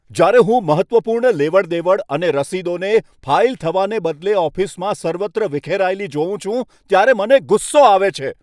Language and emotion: Gujarati, angry